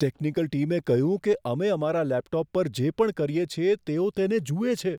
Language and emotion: Gujarati, fearful